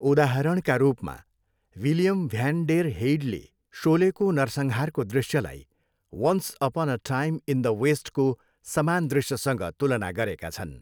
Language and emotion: Nepali, neutral